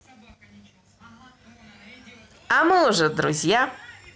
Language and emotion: Russian, positive